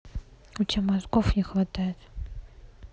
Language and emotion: Russian, neutral